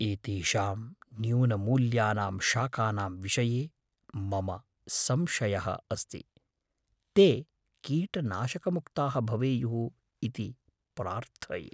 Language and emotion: Sanskrit, fearful